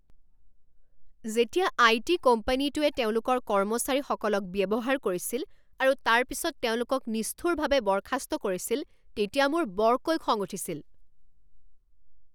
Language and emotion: Assamese, angry